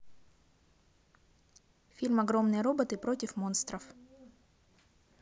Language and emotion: Russian, neutral